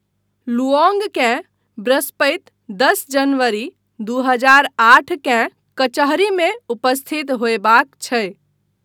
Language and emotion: Maithili, neutral